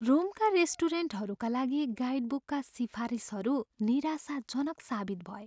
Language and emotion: Nepali, sad